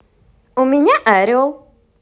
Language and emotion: Russian, positive